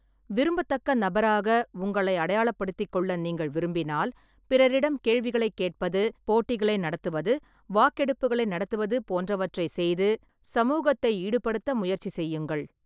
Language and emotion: Tamil, neutral